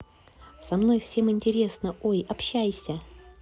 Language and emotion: Russian, positive